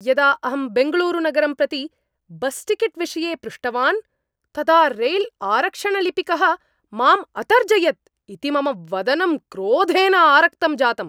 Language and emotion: Sanskrit, angry